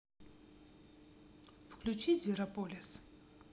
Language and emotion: Russian, neutral